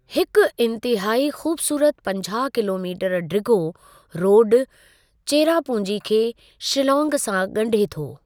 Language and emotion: Sindhi, neutral